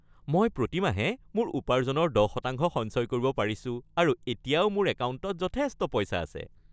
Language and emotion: Assamese, happy